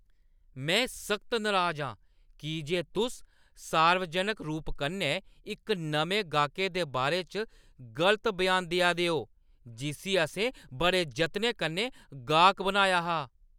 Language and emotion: Dogri, angry